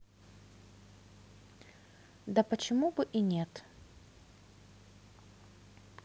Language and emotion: Russian, neutral